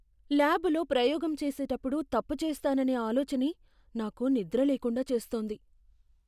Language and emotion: Telugu, fearful